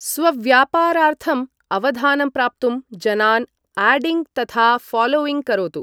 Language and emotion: Sanskrit, neutral